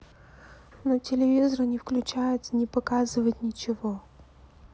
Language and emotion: Russian, sad